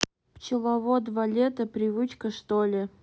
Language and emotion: Russian, neutral